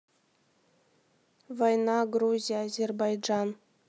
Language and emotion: Russian, neutral